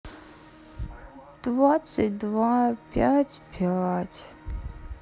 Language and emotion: Russian, sad